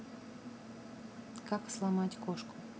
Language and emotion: Russian, neutral